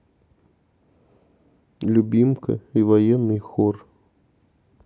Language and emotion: Russian, neutral